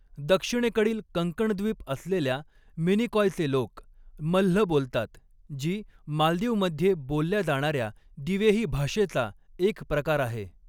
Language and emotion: Marathi, neutral